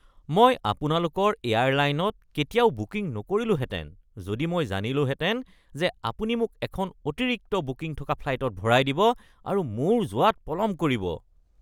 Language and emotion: Assamese, disgusted